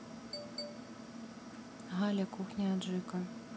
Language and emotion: Russian, neutral